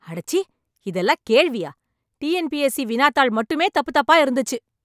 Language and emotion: Tamil, angry